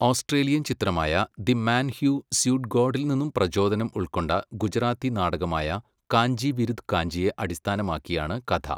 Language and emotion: Malayalam, neutral